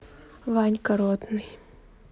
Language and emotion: Russian, neutral